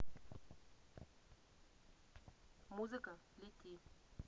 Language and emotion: Russian, neutral